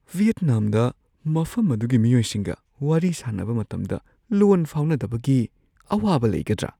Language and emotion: Manipuri, fearful